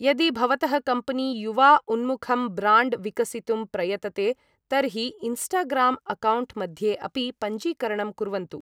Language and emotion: Sanskrit, neutral